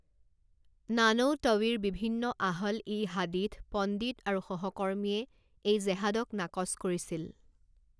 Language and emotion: Assamese, neutral